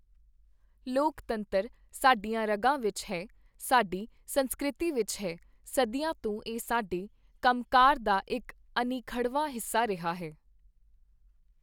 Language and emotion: Punjabi, neutral